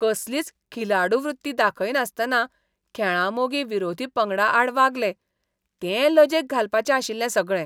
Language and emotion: Goan Konkani, disgusted